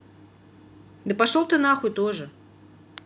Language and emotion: Russian, angry